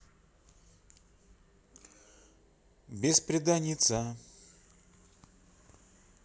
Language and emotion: Russian, neutral